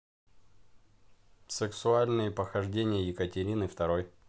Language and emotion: Russian, neutral